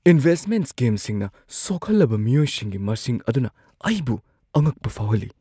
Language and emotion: Manipuri, surprised